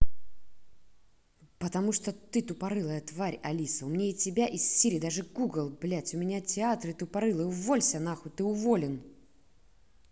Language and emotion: Russian, angry